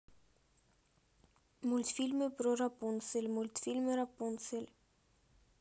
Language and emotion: Russian, neutral